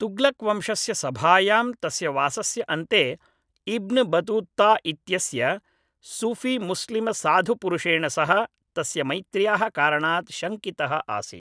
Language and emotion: Sanskrit, neutral